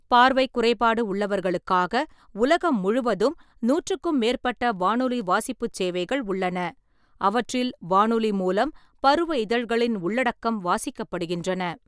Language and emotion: Tamil, neutral